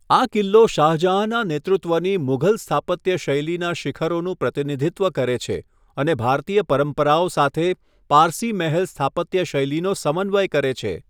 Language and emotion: Gujarati, neutral